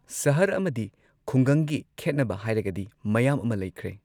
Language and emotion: Manipuri, neutral